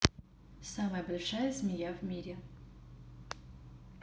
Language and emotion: Russian, neutral